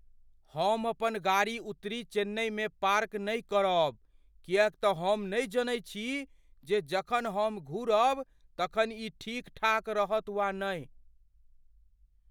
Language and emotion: Maithili, fearful